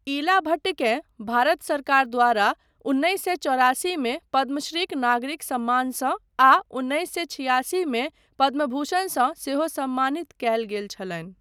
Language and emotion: Maithili, neutral